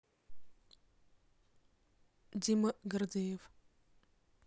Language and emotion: Russian, neutral